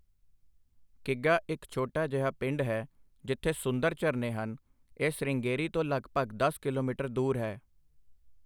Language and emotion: Punjabi, neutral